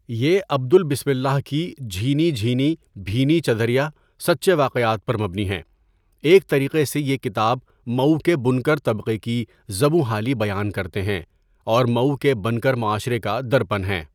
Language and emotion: Urdu, neutral